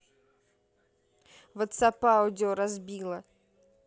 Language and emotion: Russian, neutral